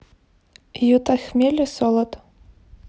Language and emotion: Russian, neutral